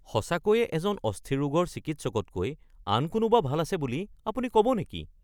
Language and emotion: Assamese, surprised